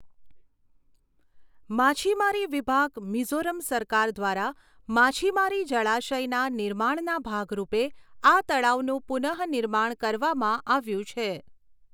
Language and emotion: Gujarati, neutral